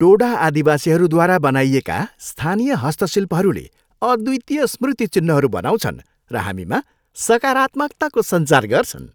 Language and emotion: Nepali, happy